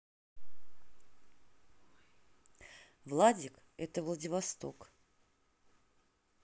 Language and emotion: Russian, neutral